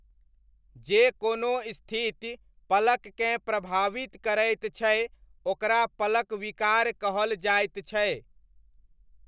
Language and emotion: Maithili, neutral